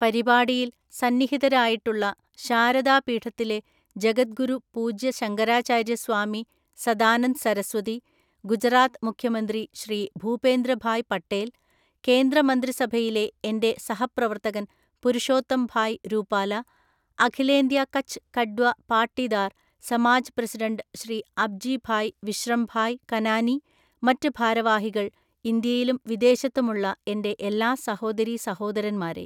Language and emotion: Malayalam, neutral